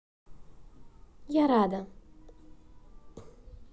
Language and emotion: Russian, positive